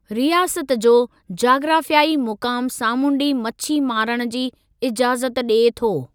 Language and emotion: Sindhi, neutral